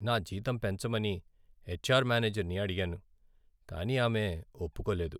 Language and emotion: Telugu, sad